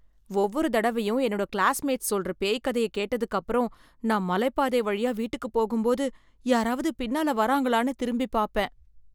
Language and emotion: Tamil, fearful